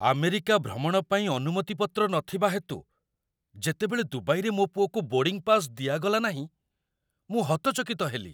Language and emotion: Odia, surprised